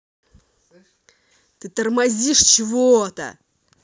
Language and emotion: Russian, angry